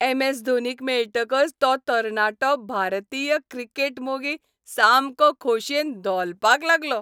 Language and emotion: Goan Konkani, happy